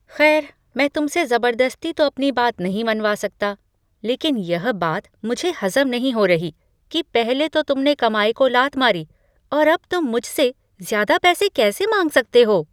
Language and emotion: Hindi, surprised